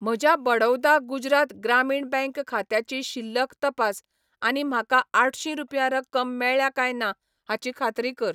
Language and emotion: Goan Konkani, neutral